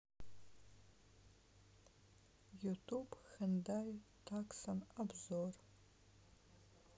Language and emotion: Russian, neutral